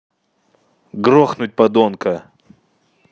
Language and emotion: Russian, angry